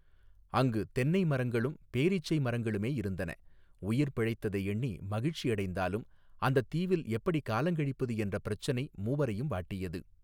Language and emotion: Tamil, neutral